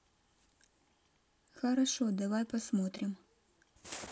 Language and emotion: Russian, neutral